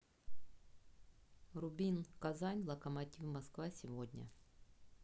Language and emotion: Russian, neutral